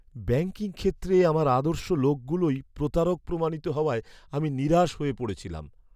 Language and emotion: Bengali, sad